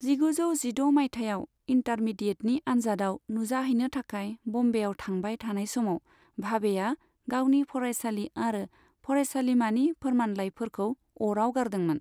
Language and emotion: Bodo, neutral